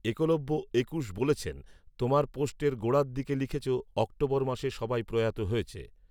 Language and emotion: Bengali, neutral